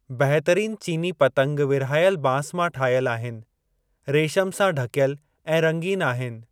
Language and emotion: Sindhi, neutral